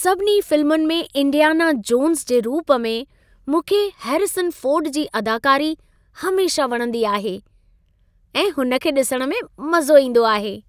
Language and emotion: Sindhi, happy